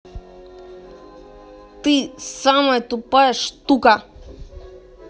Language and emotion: Russian, angry